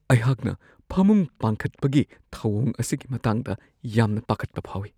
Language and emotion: Manipuri, fearful